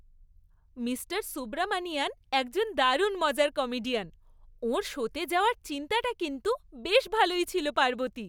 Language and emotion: Bengali, happy